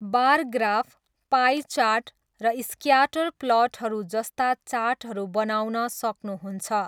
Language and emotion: Nepali, neutral